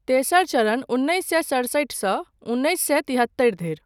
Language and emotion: Maithili, neutral